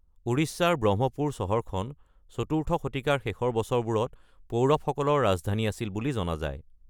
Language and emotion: Assamese, neutral